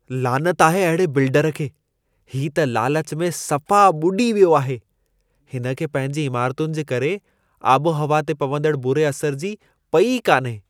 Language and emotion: Sindhi, disgusted